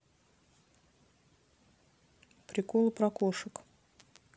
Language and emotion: Russian, neutral